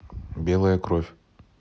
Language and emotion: Russian, neutral